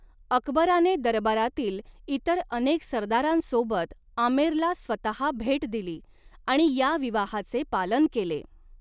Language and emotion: Marathi, neutral